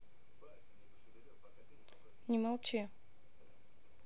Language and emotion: Russian, neutral